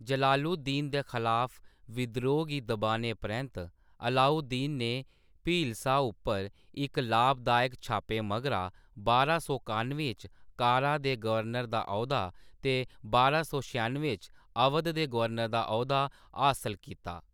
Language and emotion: Dogri, neutral